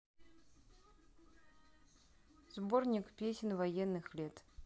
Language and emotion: Russian, neutral